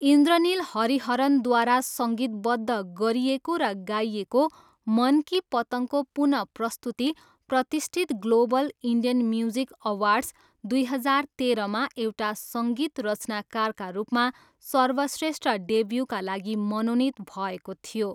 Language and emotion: Nepali, neutral